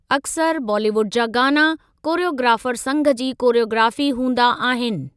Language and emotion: Sindhi, neutral